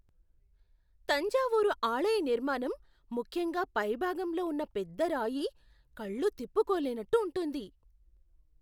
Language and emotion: Telugu, surprised